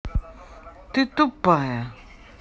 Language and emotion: Russian, angry